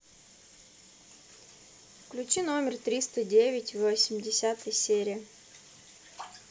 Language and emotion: Russian, neutral